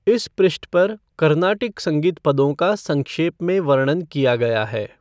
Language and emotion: Hindi, neutral